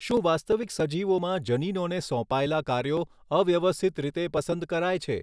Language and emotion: Gujarati, neutral